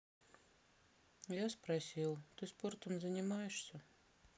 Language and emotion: Russian, sad